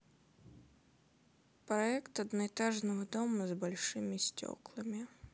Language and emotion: Russian, sad